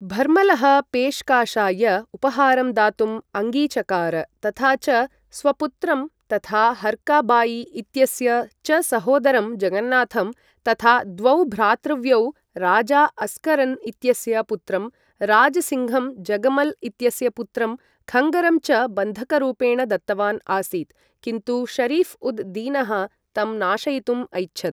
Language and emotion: Sanskrit, neutral